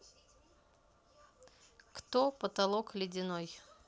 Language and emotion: Russian, neutral